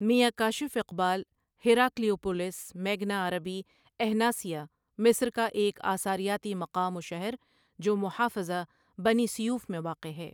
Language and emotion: Urdu, neutral